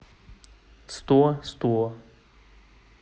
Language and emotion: Russian, neutral